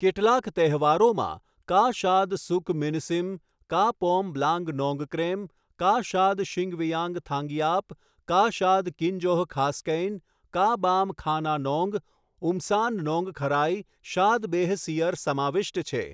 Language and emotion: Gujarati, neutral